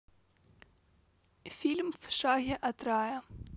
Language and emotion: Russian, neutral